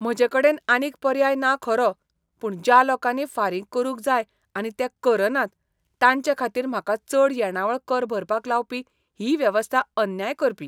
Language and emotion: Goan Konkani, disgusted